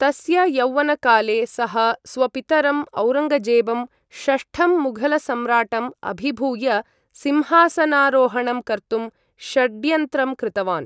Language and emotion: Sanskrit, neutral